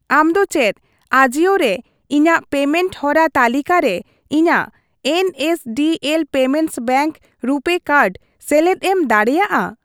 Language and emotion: Santali, neutral